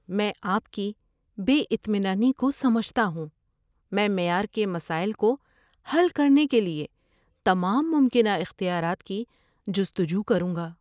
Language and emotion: Urdu, sad